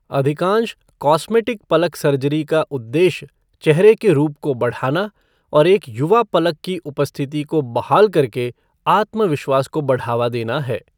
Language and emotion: Hindi, neutral